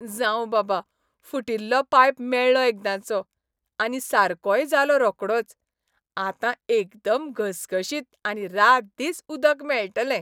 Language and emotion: Goan Konkani, happy